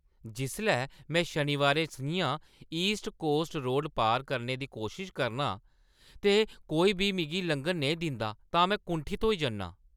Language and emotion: Dogri, angry